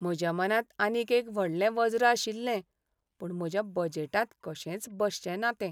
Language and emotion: Goan Konkani, sad